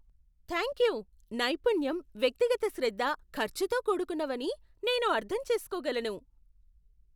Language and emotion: Telugu, surprised